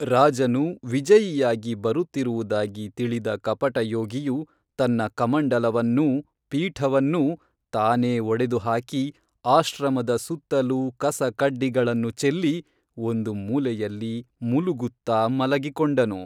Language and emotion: Kannada, neutral